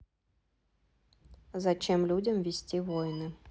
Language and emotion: Russian, neutral